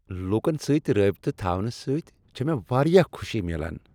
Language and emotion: Kashmiri, happy